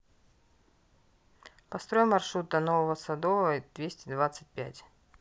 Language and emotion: Russian, neutral